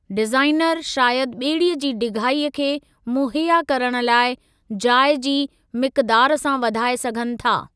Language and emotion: Sindhi, neutral